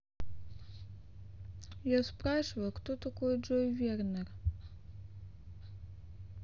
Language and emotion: Russian, sad